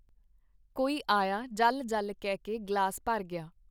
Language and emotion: Punjabi, neutral